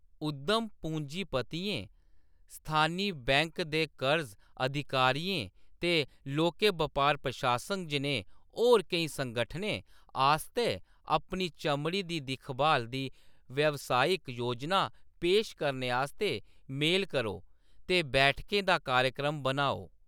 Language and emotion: Dogri, neutral